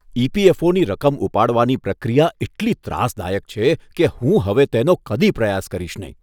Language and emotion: Gujarati, disgusted